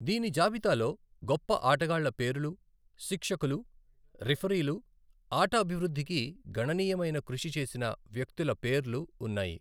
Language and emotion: Telugu, neutral